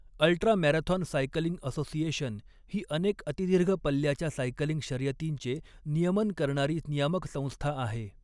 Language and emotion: Marathi, neutral